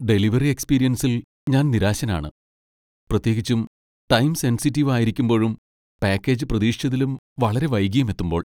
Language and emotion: Malayalam, sad